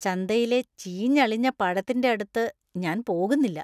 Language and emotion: Malayalam, disgusted